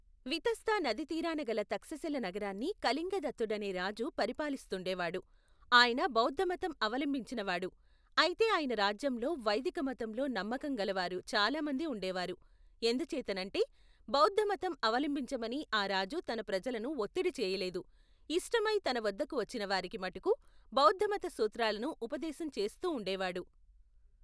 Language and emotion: Telugu, neutral